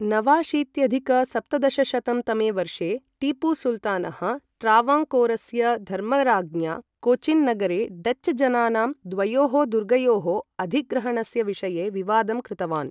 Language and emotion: Sanskrit, neutral